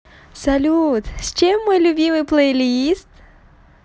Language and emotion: Russian, positive